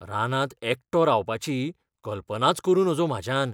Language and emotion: Goan Konkani, fearful